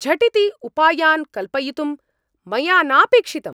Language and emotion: Sanskrit, angry